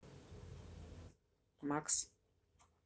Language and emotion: Russian, neutral